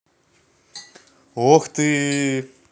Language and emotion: Russian, positive